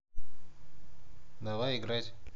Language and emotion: Russian, neutral